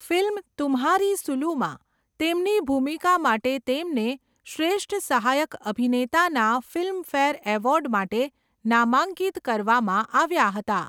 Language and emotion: Gujarati, neutral